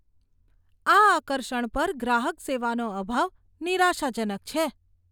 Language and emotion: Gujarati, disgusted